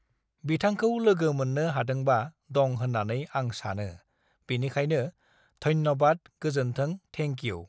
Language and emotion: Bodo, neutral